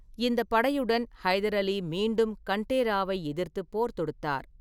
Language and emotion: Tamil, neutral